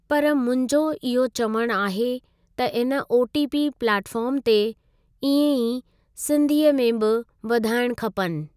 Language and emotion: Sindhi, neutral